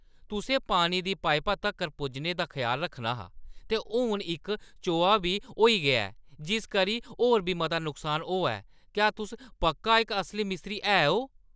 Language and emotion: Dogri, angry